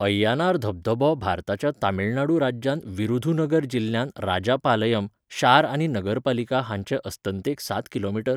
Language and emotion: Goan Konkani, neutral